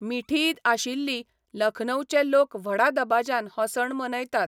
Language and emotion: Goan Konkani, neutral